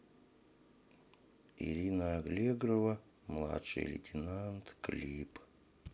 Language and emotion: Russian, neutral